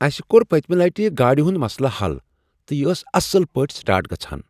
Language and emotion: Kashmiri, surprised